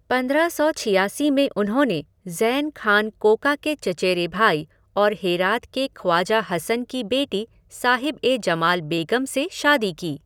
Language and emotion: Hindi, neutral